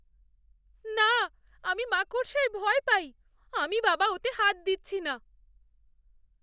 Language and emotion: Bengali, fearful